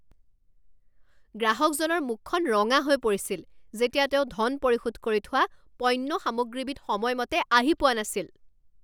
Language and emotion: Assamese, angry